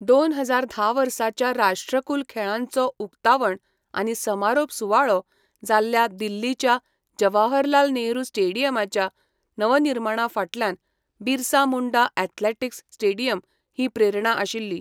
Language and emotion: Goan Konkani, neutral